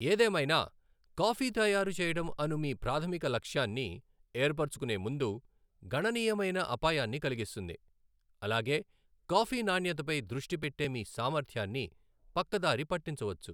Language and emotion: Telugu, neutral